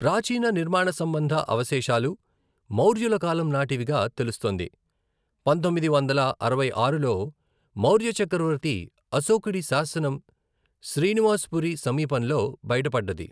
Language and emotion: Telugu, neutral